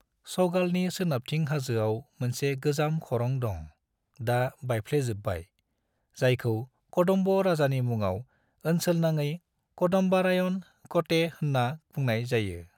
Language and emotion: Bodo, neutral